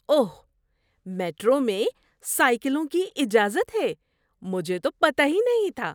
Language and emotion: Urdu, surprised